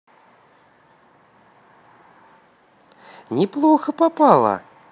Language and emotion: Russian, positive